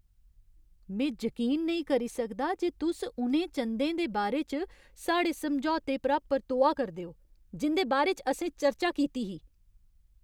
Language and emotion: Dogri, angry